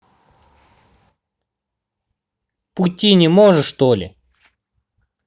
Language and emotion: Russian, angry